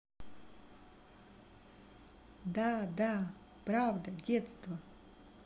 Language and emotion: Russian, positive